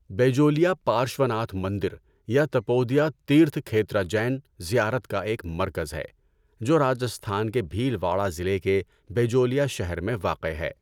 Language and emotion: Urdu, neutral